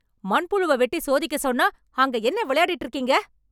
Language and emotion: Tamil, angry